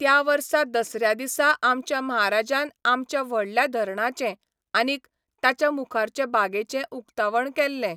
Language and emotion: Goan Konkani, neutral